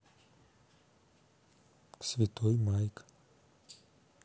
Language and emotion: Russian, neutral